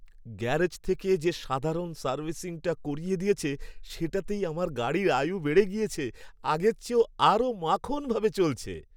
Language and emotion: Bengali, happy